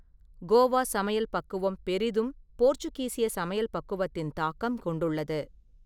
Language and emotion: Tamil, neutral